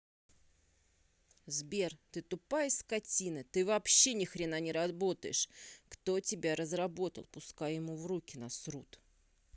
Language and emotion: Russian, angry